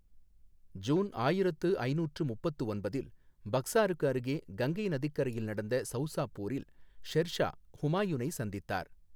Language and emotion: Tamil, neutral